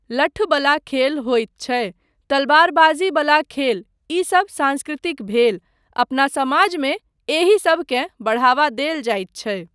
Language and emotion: Maithili, neutral